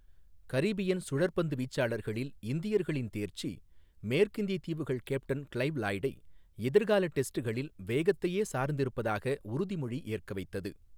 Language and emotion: Tamil, neutral